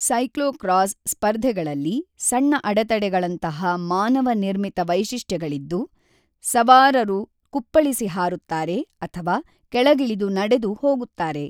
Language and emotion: Kannada, neutral